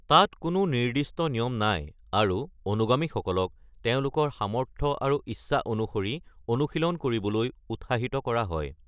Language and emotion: Assamese, neutral